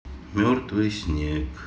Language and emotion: Russian, sad